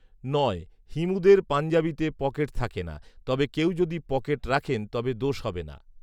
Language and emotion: Bengali, neutral